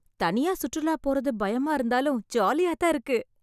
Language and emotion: Tamil, happy